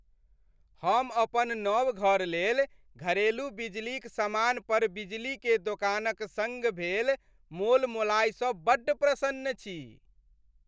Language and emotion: Maithili, happy